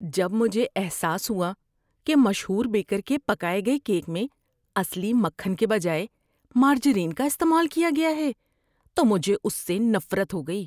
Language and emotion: Urdu, disgusted